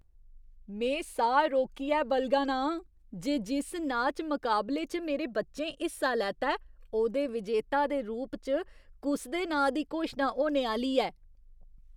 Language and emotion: Dogri, surprised